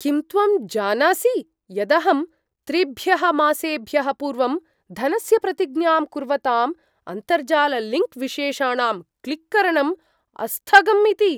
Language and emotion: Sanskrit, surprised